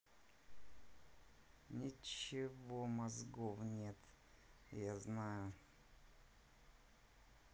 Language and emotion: Russian, angry